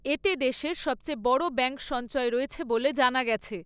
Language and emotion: Bengali, neutral